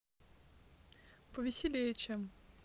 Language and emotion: Russian, neutral